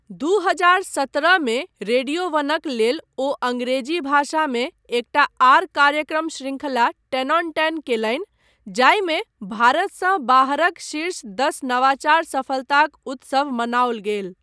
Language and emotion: Maithili, neutral